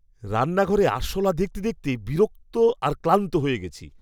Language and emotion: Bengali, disgusted